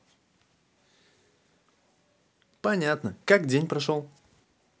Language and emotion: Russian, positive